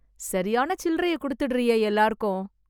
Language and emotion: Tamil, surprised